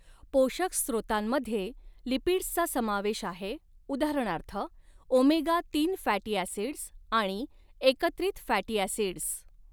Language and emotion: Marathi, neutral